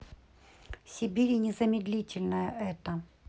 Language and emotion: Russian, neutral